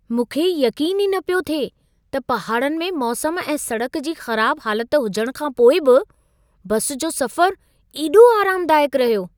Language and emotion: Sindhi, surprised